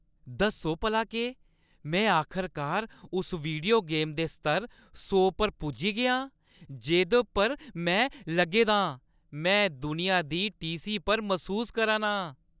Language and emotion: Dogri, happy